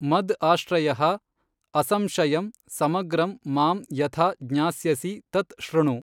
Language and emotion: Kannada, neutral